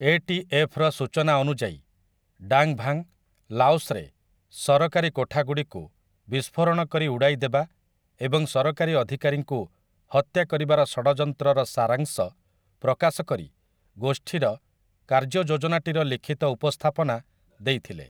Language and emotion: Odia, neutral